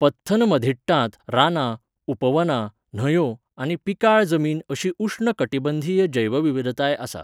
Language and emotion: Goan Konkani, neutral